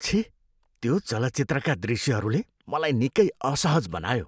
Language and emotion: Nepali, disgusted